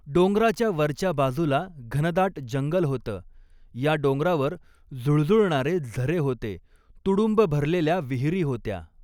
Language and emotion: Marathi, neutral